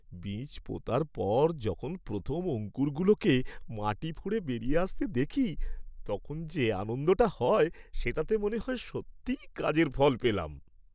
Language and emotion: Bengali, happy